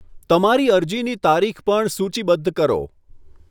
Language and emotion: Gujarati, neutral